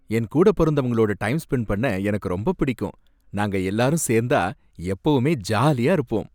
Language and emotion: Tamil, happy